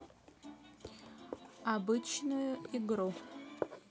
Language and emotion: Russian, neutral